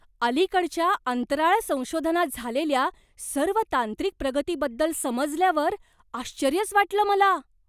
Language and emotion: Marathi, surprised